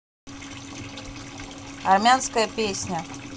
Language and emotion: Russian, neutral